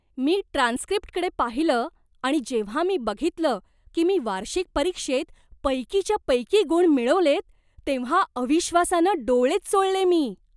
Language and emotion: Marathi, surprised